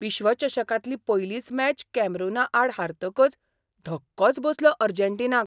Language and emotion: Goan Konkani, surprised